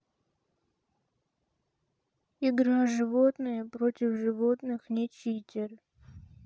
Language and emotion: Russian, sad